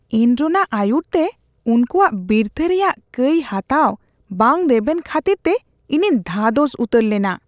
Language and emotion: Santali, disgusted